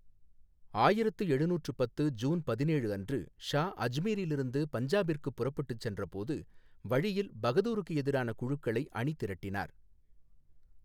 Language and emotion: Tamil, neutral